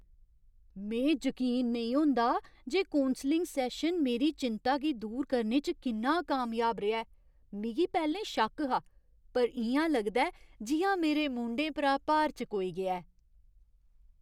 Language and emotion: Dogri, surprised